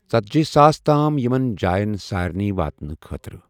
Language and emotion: Kashmiri, neutral